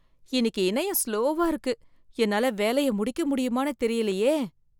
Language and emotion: Tamil, fearful